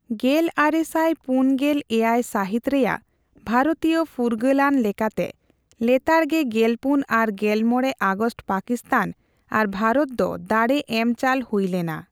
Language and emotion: Santali, neutral